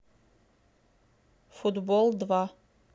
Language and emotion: Russian, neutral